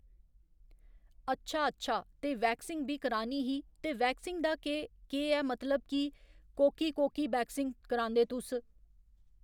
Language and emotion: Dogri, neutral